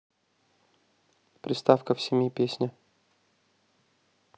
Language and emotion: Russian, neutral